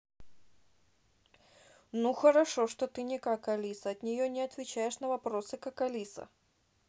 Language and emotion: Russian, neutral